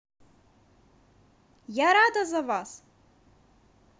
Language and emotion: Russian, positive